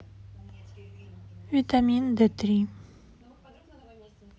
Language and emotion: Russian, neutral